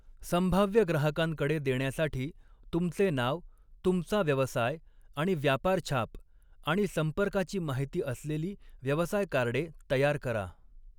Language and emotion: Marathi, neutral